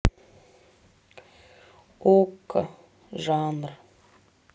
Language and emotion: Russian, sad